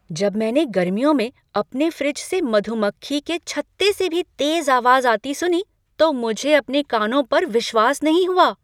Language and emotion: Hindi, surprised